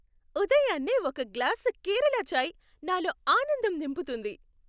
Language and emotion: Telugu, happy